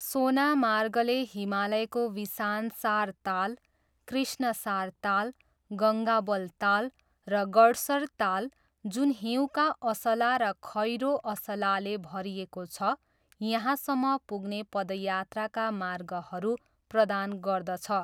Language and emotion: Nepali, neutral